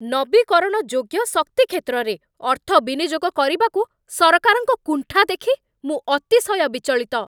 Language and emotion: Odia, angry